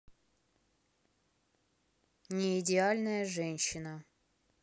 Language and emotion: Russian, neutral